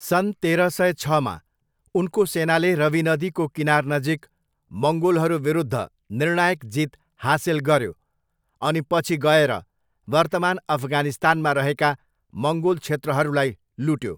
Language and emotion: Nepali, neutral